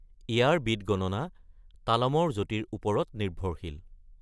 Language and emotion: Assamese, neutral